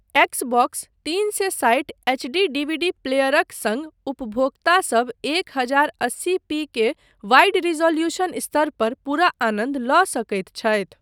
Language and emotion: Maithili, neutral